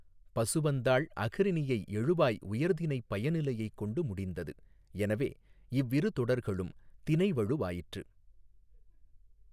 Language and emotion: Tamil, neutral